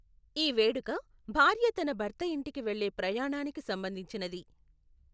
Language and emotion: Telugu, neutral